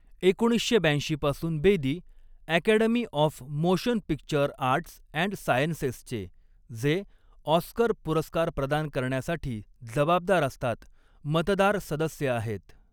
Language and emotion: Marathi, neutral